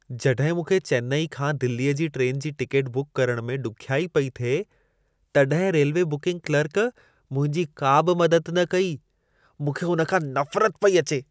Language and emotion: Sindhi, disgusted